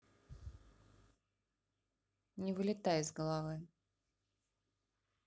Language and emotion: Russian, neutral